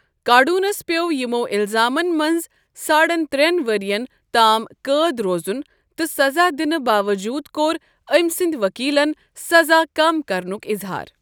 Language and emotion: Kashmiri, neutral